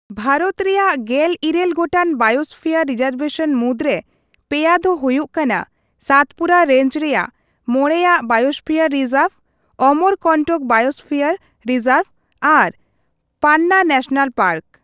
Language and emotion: Santali, neutral